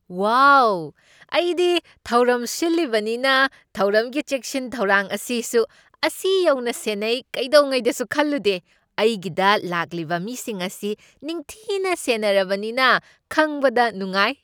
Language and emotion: Manipuri, surprised